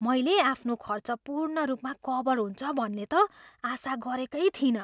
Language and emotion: Nepali, surprised